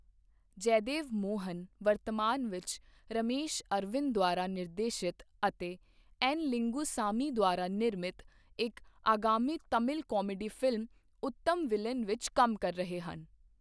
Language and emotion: Punjabi, neutral